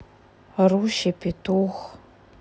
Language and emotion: Russian, sad